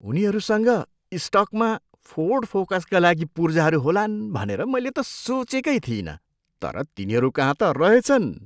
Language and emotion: Nepali, surprised